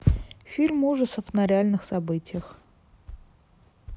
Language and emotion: Russian, neutral